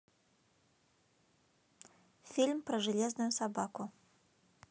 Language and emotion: Russian, neutral